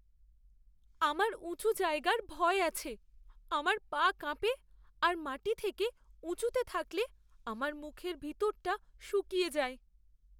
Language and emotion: Bengali, fearful